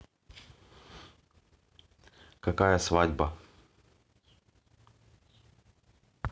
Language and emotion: Russian, neutral